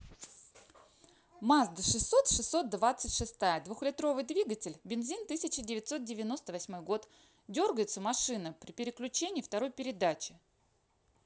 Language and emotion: Russian, neutral